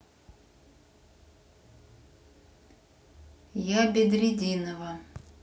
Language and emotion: Russian, neutral